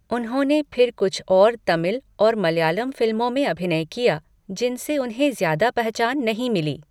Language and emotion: Hindi, neutral